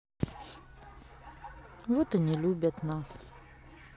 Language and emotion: Russian, sad